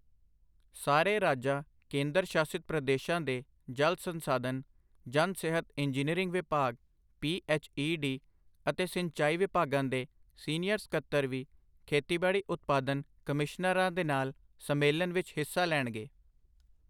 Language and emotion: Punjabi, neutral